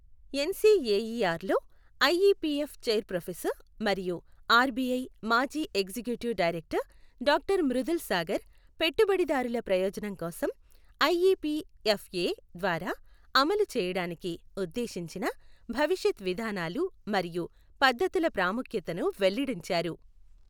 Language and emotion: Telugu, neutral